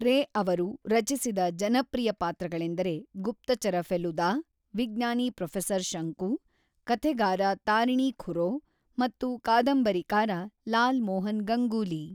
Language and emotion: Kannada, neutral